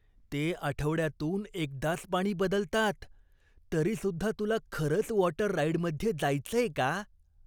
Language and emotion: Marathi, disgusted